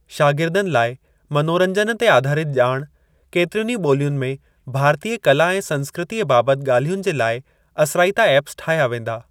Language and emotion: Sindhi, neutral